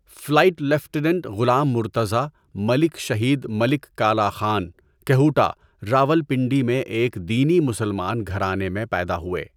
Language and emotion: Urdu, neutral